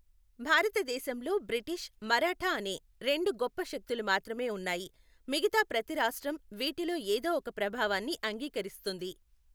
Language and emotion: Telugu, neutral